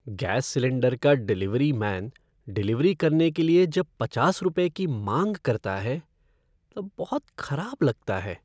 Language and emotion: Hindi, sad